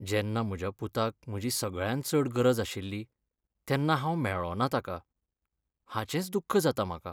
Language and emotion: Goan Konkani, sad